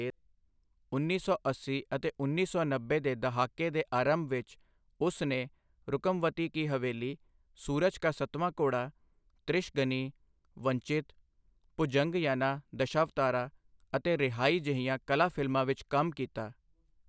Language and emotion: Punjabi, neutral